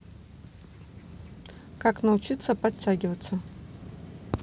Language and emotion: Russian, neutral